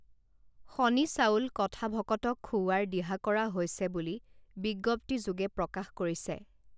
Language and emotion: Assamese, neutral